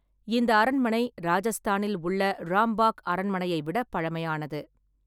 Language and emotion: Tamil, neutral